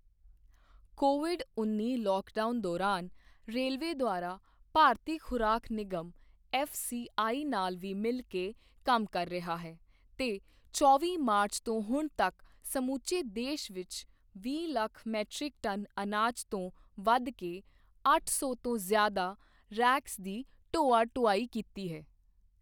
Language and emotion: Punjabi, neutral